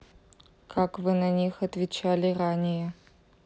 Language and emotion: Russian, neutral